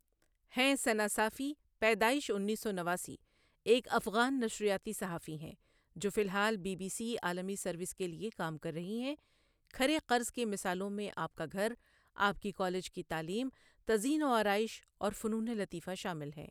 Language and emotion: Urdu, neutral